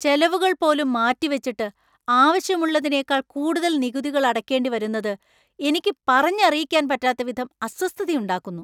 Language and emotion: Malayalam, angry